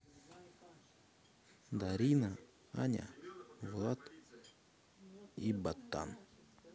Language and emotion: Russian, neutral